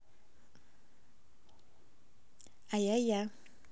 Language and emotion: Russian, positive